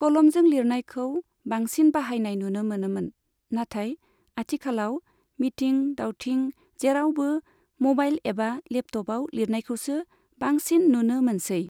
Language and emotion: Bodo, neutral